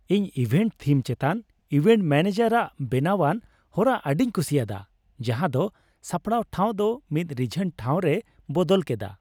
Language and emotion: Santali, happy